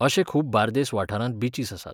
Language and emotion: Goan Konkani, neutral